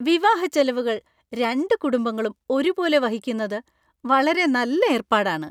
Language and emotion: Malayalam, happy